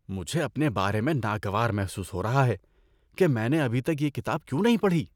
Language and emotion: Urdu, disgusted